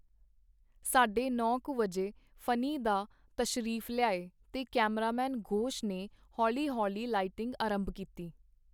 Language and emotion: Punjabi, neutral